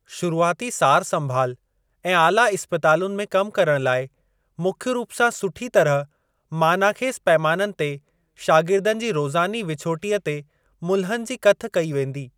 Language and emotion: Sindhi, neutral